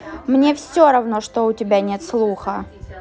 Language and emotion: Russian, angry